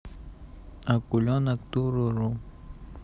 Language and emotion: Russian, neutral